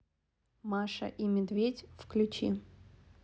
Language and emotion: Russian, neutral